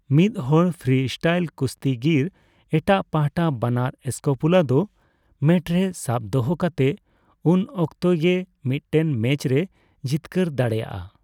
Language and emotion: Santali, neutral